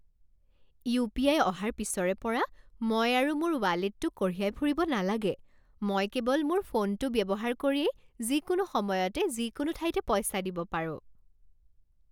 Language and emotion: Assamese, happy